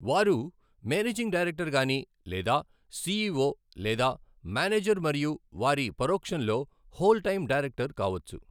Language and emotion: Telugu, neutral